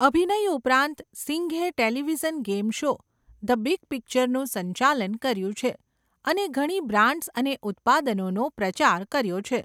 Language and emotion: Gujarati, neutral